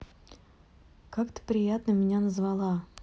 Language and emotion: Russian, neutral